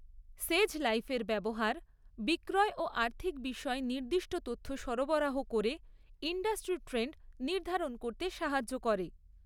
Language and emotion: Bengali, neutral